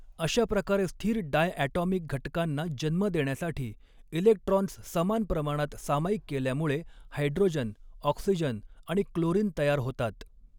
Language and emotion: Marathi, neutral